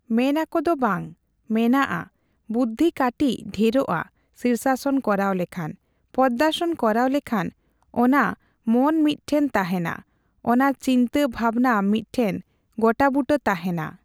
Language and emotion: Santali, neutral